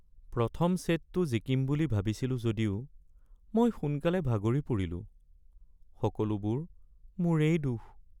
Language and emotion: Assamese, sad